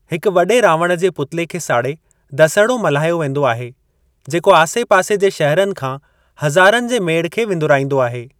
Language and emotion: Sindhi, neutral